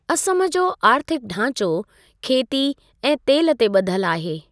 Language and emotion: Sindhi, neutral